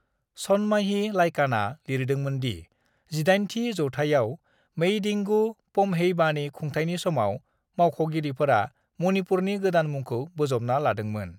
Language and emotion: Bodo, neutral